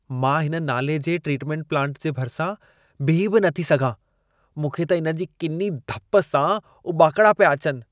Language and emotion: Sindhi, disgusted